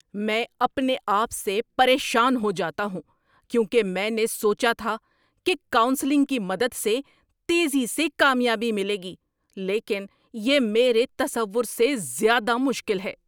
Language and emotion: Urdu, angry